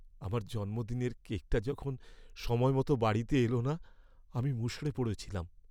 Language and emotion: Bengali, sad